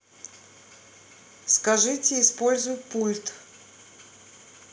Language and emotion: Russian, neutral